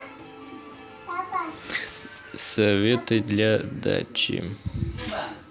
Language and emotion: Russian, neutral